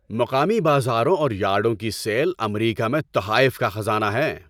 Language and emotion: Urdu, happy